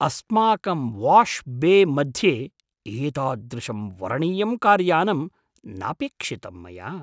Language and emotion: Sanskrit, surprised